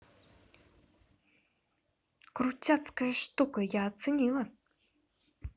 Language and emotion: Russian, positive